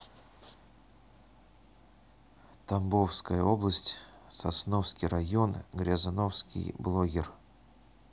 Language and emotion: Russian, neutral